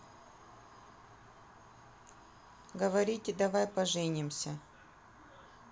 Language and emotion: Russian, neutral